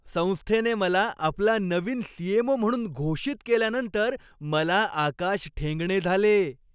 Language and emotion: Marathi, happy